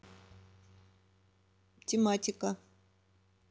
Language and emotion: Russian, neutral